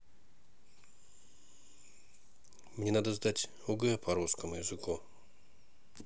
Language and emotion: Russian, neutral